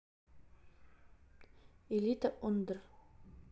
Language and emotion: Russian, neutral